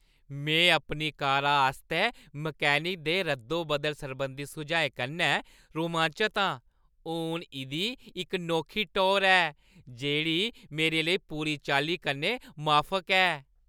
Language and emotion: Dogri, happy